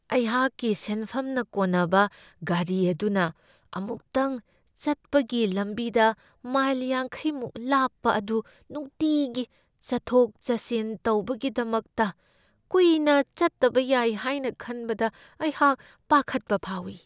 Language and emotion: Manipuri, fearful